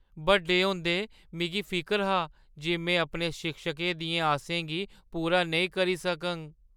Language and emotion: Dogri, fearful